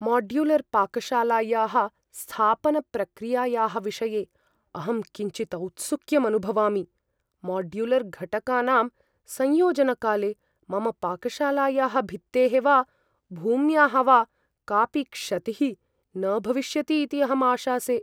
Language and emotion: Sanskrit, fearful